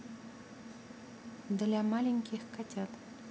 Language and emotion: Russian, neutral